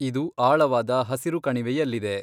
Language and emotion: Kannada, neutral